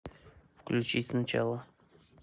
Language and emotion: Russian, neutral